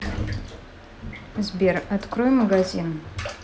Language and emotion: Russian, neutral